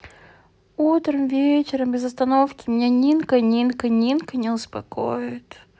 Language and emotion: Russian, sad